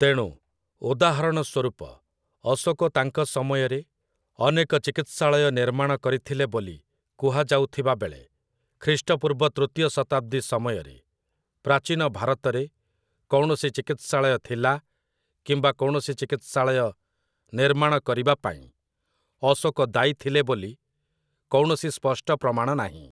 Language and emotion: Odia, neutral